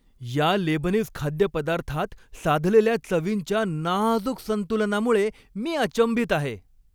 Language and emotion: Marathi, happy